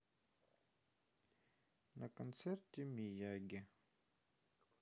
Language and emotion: Russian, sad